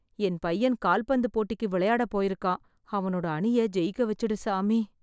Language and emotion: Tamil, sad